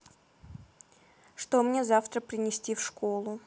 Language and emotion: Russian, neutral